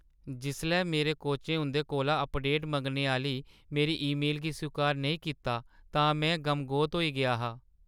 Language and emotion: Dogri, sad